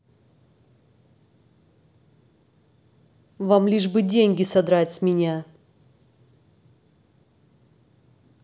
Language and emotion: Russian, angry